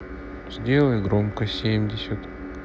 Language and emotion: Russian, sad